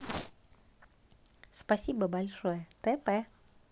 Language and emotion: Russian, neutral